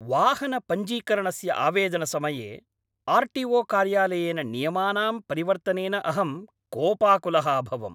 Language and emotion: Sanskrit, angry